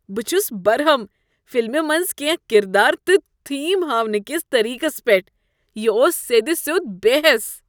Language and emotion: Kashmiri, disgusted